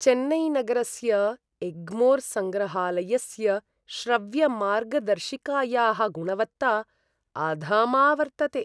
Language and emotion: Sanskrit, disgusted